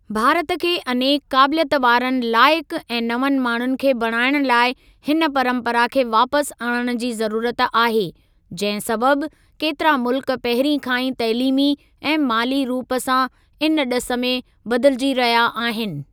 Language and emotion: Sindhi, neutral